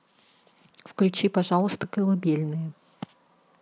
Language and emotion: Russian, neutral